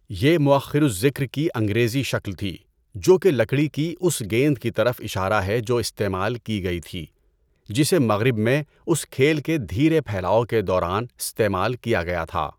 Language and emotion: Urdu, neutral